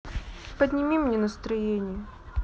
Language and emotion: Russian, sad